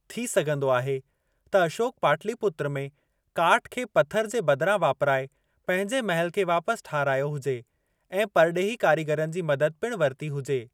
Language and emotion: Sindhi, neutral